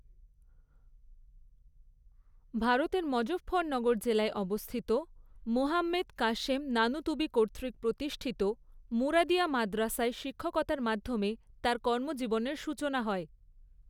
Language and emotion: Bengali, neutral